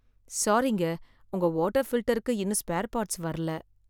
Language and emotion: Tamil, sad